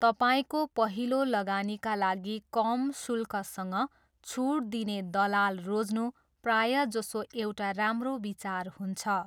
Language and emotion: Nepali, neutral